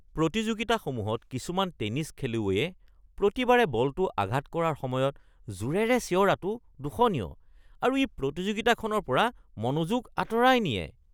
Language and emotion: Assamese, disgusted